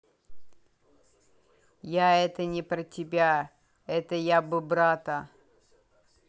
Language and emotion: Russian, neutral